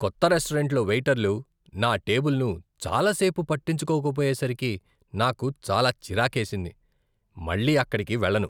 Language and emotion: Telugu, disgusted